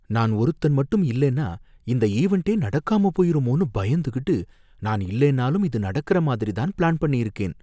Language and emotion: Tamil, fearful